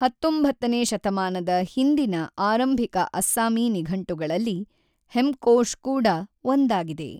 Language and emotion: Kannada, neutral